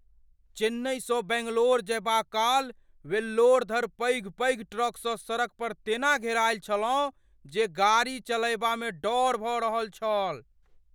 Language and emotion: Maithili, fearful